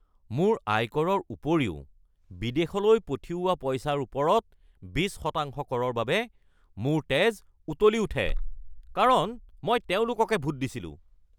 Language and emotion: Assamese, angry